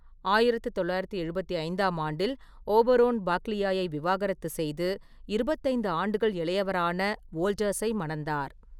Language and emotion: Tamil, neutral